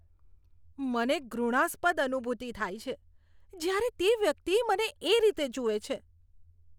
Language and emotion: Gujarati, disgusted